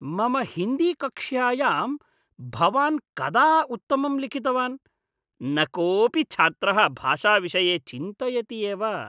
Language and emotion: Sanskrit, disgusted